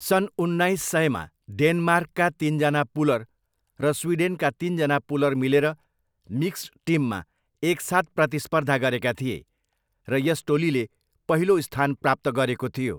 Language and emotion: Nepali, neutral